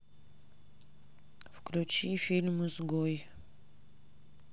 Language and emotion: Russian, neutral